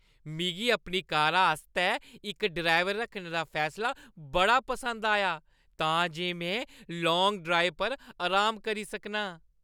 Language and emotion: Dogri, happy